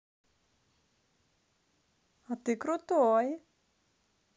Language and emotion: Russian, positive